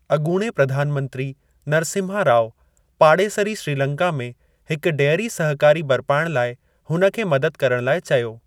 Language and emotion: Sindhi, neutral